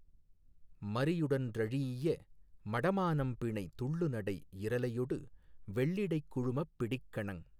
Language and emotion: Tamil, neutral